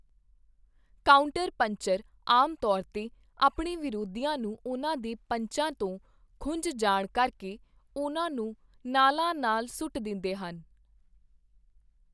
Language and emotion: Punjabi, neutral